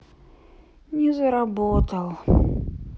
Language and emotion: Russian, sad